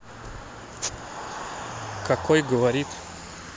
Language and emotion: Russian, neutral